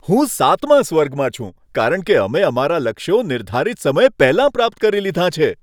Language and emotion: Gujarati, happy